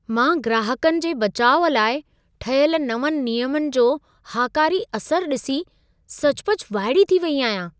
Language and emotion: Sindhi, surprised